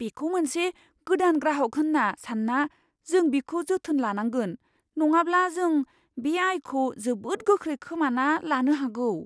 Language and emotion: Bodo, fearful